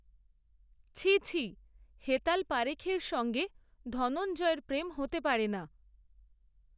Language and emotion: Bengali, neutral